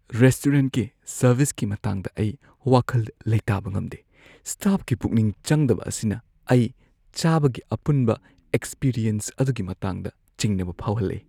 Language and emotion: Manipuri, fearful